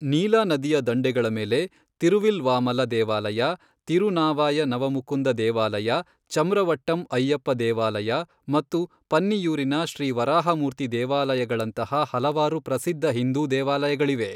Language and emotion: Kannada, neutral